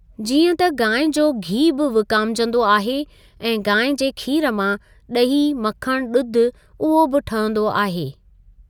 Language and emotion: Sindhi, neutral